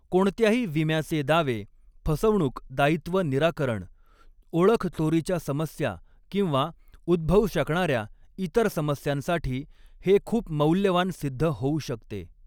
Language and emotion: Marathi, neutral